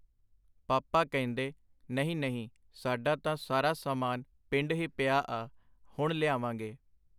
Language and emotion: Punjabi, neutral